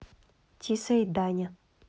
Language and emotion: Russian, neutral